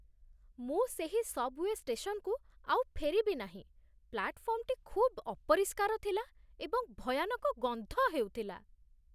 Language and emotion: Odia, disgusted